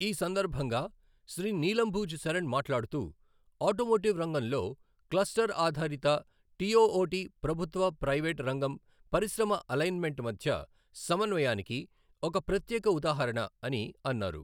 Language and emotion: Telugu, neutral